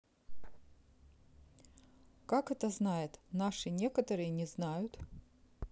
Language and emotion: Russian, neutral